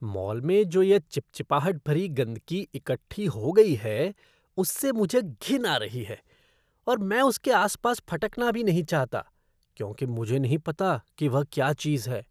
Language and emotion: Hindi, disgusted